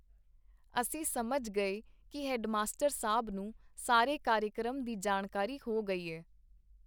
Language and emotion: Punjabi, neutral